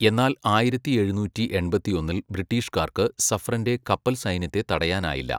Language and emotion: Malayalam, neutral